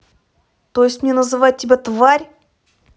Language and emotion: Russian, angry